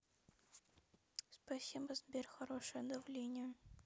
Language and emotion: Russian, sad